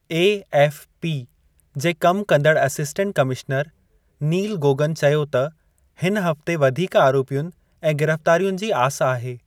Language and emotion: Sindhi, neutral